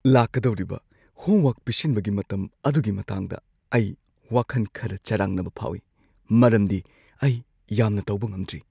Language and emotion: Manipuri, fearful